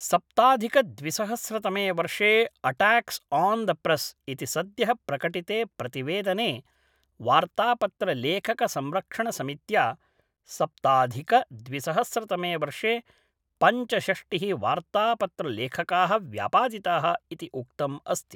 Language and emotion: Sanskrit, neutral